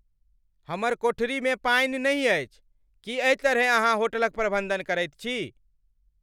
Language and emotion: Maithili, angry